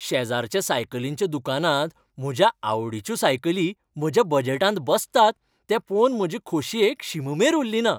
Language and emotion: Goan Konkani, happy